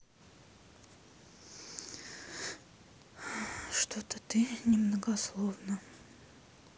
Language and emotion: Russian, sad